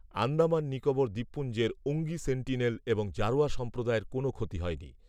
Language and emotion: Bengali, neutral